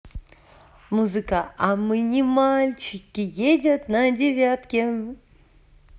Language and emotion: Russian, positive